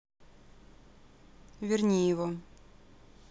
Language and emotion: Russian, neutral